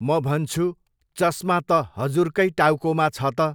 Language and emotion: Nepali, neutral